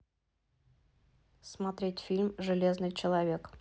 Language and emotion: Russian, neutral